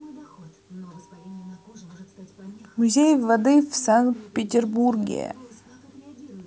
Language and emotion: Russian, neutral